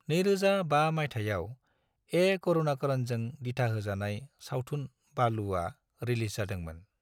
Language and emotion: Bodo, neutral